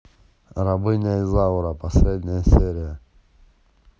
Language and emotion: Russian, neutral